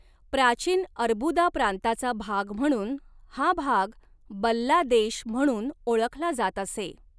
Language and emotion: Marathi, neutral